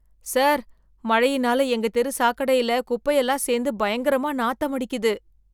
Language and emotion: Tamil, disgusted